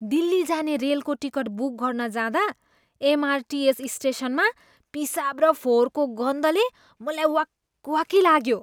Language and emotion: Nepali, disgusted